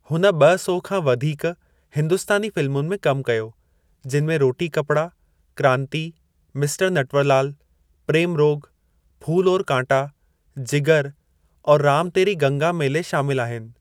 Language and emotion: Sindhi, neutral